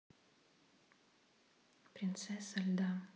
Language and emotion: Russian, neutral